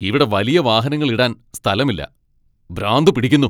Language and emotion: Malayalam, angry